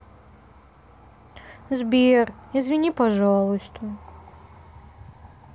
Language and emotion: Russian, sad